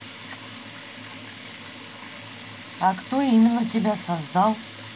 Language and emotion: Russian, neutral